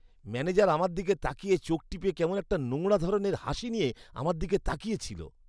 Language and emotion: Bengali, disgusted